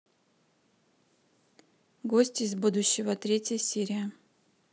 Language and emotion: Russian, neutral